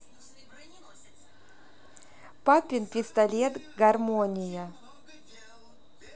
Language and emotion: Russian, neutral